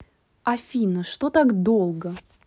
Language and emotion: Russian, angry